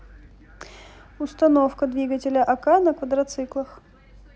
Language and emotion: Russian, neutral